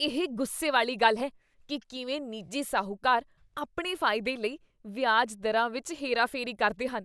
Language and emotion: Punjabi, disgusted